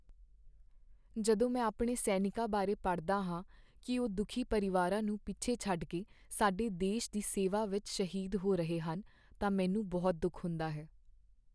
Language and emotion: Punjabi, sad